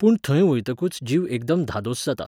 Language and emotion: Goan Konkani, neutral